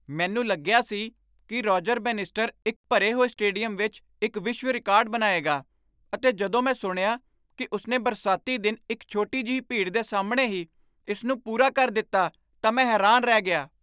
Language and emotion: Punjabi, surprised